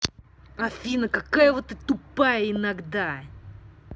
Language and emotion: Russian, angry